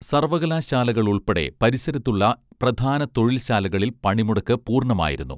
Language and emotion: Malayalam, neutral